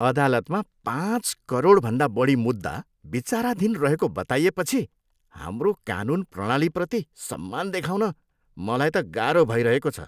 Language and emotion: Nepali, disgusted